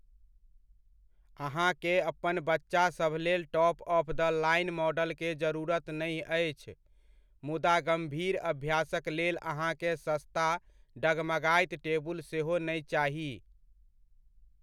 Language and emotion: Maithili, neutral